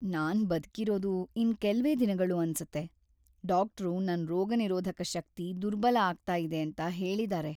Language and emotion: Kannada, sad